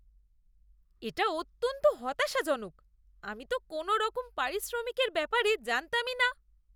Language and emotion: Bengali, disgusted